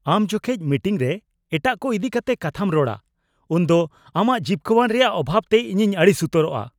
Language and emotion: Santali, angry